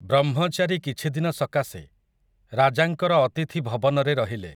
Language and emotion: Odia, neutral